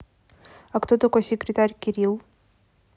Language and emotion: Russian, neutral